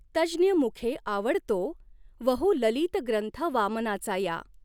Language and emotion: Marathi, neutral